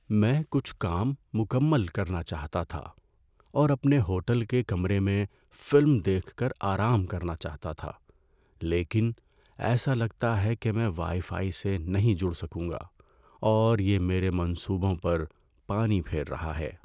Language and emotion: Urdu, sad